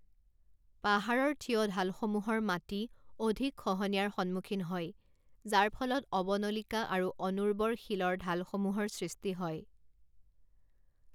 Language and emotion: Assamese, neutral